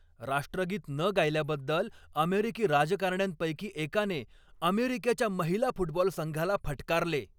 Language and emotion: Marathi, angry